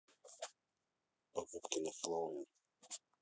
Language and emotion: Russian, neutral